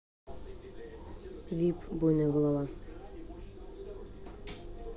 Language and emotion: Russian, neutral